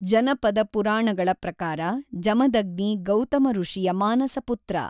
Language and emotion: Kannada, neutral